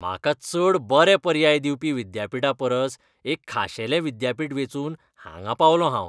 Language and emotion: Goan Konkani, disgusted